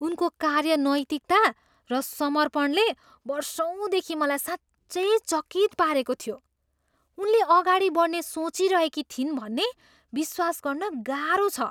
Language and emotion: Nepali, surprised